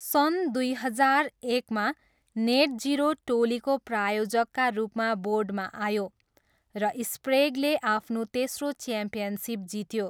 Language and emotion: Nepali, neutral